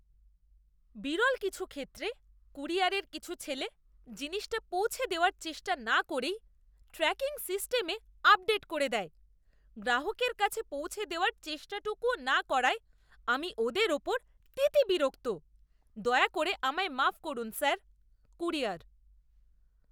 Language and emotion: Bengali, disgusted